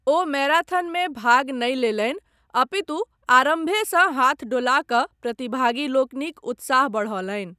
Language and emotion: Maithili, neutral